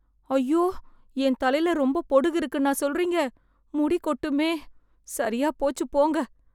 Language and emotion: Tamil, sad